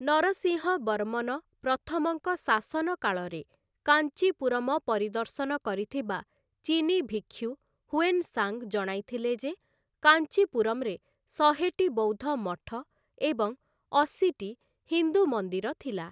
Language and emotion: Odia, neutral